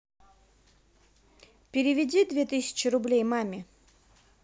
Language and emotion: Russian, neutral